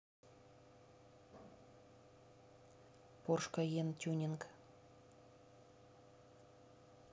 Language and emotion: Russian, neutral